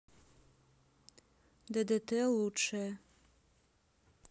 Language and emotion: Russian, neutral